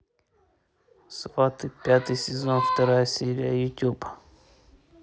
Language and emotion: Russian, neutral